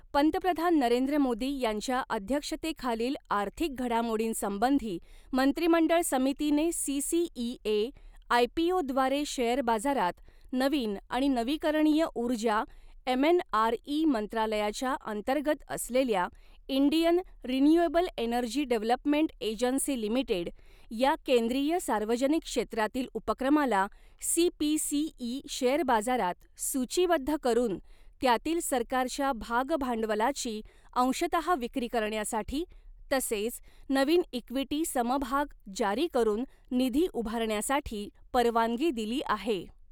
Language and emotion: Marathi, neutral